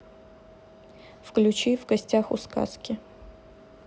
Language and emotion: Russian, neutral